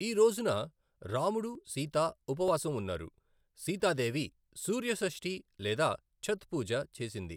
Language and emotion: Telugu, neutral